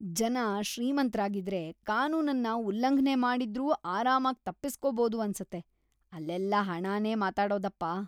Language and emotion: Kannada, disgusted